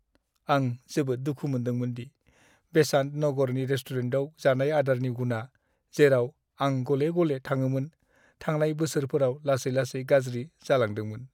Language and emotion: Bodo, sad